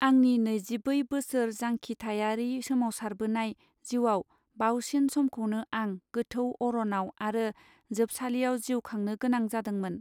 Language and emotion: Bodo, neutral